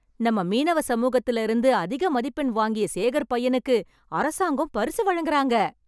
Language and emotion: Tamil, happy